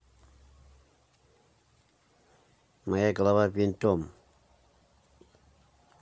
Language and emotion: Russian, neutral